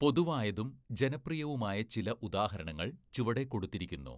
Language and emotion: Malayalam, neutral